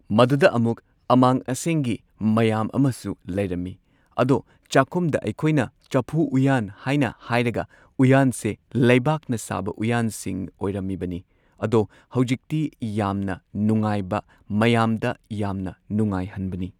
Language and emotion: Manipuri, neutral